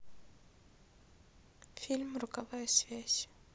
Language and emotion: Russian, sad